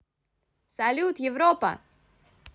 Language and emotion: Russian, positive